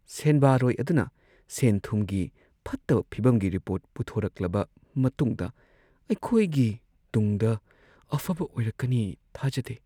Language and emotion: Manipuri, sad